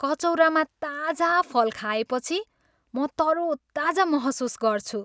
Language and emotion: Nepali, happy